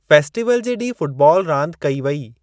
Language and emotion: Sindhi, neutral